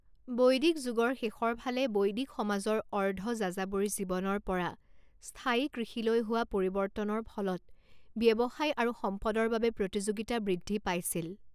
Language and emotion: Assamese, neutral